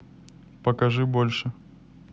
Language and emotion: Russian, neutral